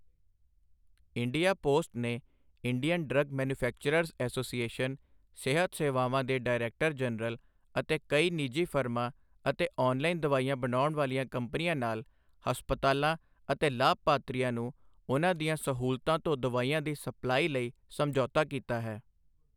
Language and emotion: Punjabi, neutral